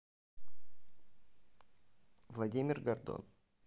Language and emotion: Russian, neutral